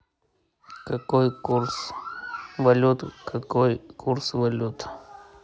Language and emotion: Russian, neutral